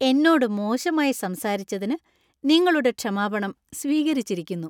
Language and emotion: Malayalam, happy